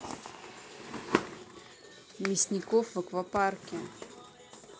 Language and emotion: Russian, neutral